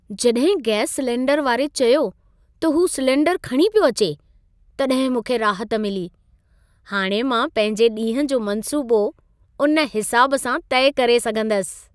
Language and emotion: Sindhi, happy